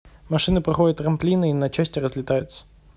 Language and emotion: Russian, neutral